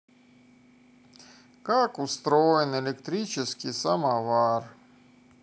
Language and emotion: Russian, neutral